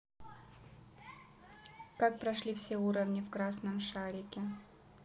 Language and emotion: Russian, neutral